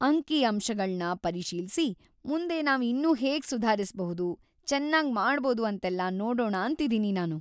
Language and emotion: Kannada, happy